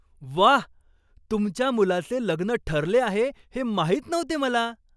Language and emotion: Marathi, surprised